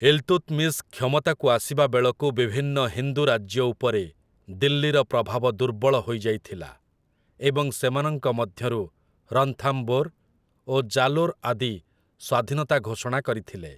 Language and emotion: Odia, neutral